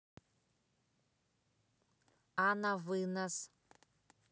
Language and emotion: Russian, neutral